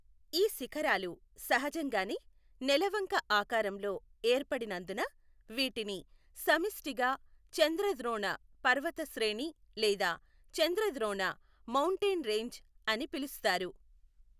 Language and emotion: Telugu, neutral